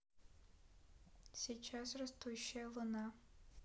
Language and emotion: Russian, sad